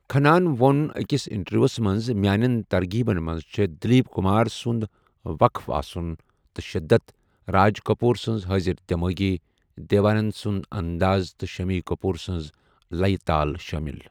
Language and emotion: Kashmiri, neutral